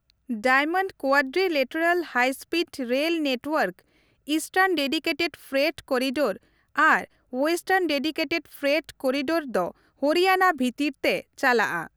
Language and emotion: Santali, neutral